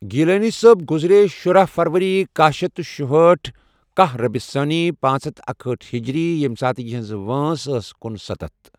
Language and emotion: Kashmiri, neutral